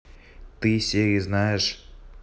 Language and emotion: Russian, neutral